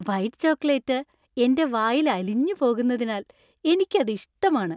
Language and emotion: Malayalam, happy